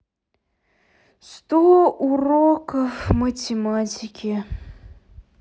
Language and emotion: Russian, sad